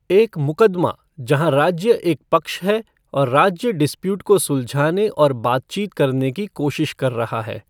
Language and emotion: Hindi, neutral